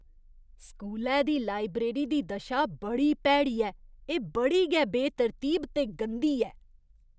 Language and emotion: Dogri, disgusted